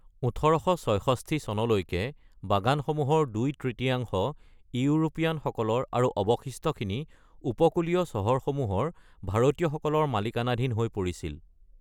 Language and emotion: Assamese, neutral